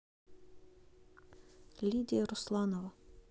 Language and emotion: Russian, neutral